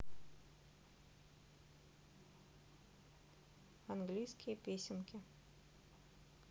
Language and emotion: Russian, neutral